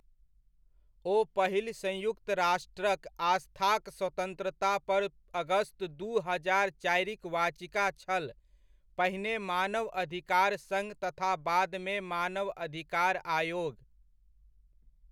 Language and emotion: Maithili, neutral